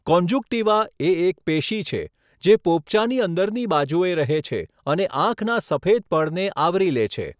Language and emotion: Gujarati, neutral